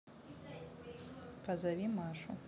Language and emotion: Russian, neutral